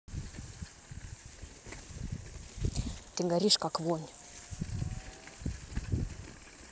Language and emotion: Russian, angry